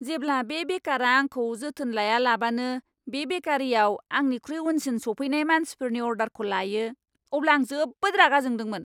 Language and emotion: Bodo, angry